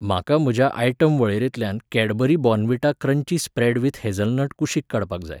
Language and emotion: Goan Konkani, neutral